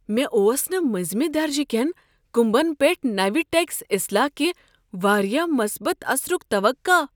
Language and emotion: Kashmiri, surprised